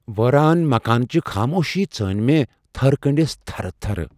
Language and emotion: Kashmiri, fearful